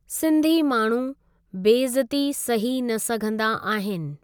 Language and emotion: Sindhi, neutral